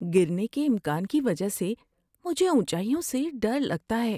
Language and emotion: Urdu, fearful